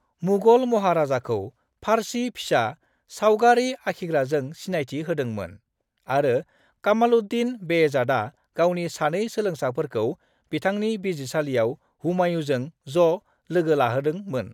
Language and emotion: Bodo, neutral